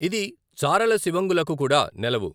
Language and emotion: Telugu, neutral